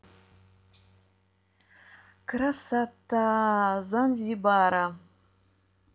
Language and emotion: Russian, positive